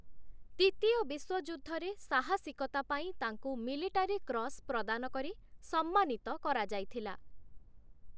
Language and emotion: Odia, neutral